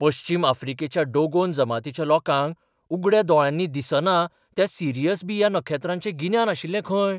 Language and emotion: Goan Konkani, surprised